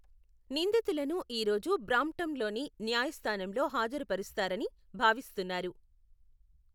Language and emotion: Telugu, neutral